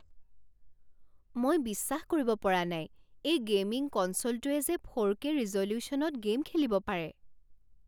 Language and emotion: Assamese, surprised